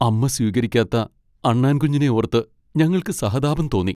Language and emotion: Malayalam, sad